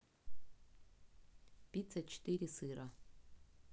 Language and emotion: Russian, neutral